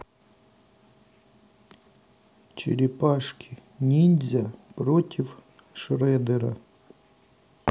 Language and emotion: Russian, neutral